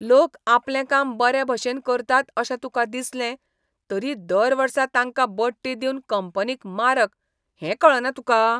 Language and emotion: Goan Konkani, disgusted